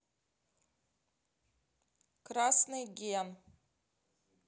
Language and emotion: Russian, neutral